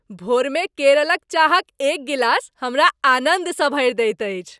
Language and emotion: Maithili, happy